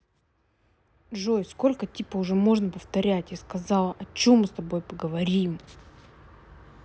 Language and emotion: Russian, angry